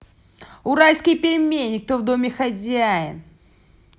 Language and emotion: Russian, angry